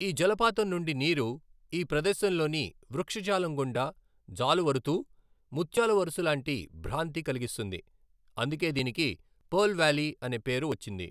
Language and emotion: Telugu, neutral